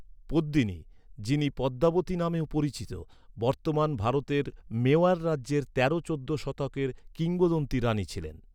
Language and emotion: Bengali, neutral